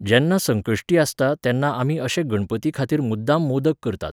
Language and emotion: Goan Konkani, neutral